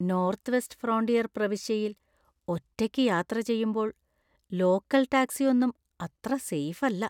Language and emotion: Malayalam, fearful